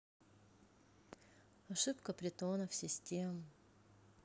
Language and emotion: Russian, neutral